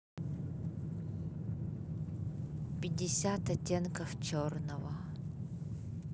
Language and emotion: Russian, neutral